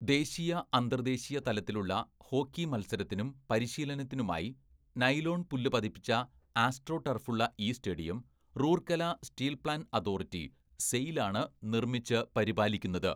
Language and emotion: Malayalam, neutral